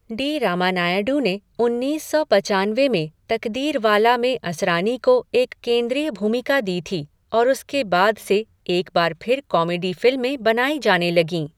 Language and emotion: Hindi, neutral